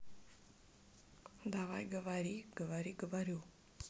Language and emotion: Russian, neutral